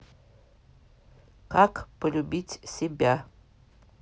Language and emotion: Russian, neutral